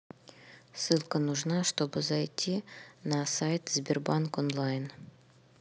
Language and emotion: Russian, neutral